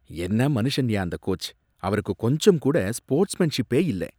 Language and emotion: Tamil, disgusted